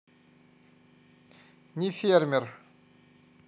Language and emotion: Russian, neutral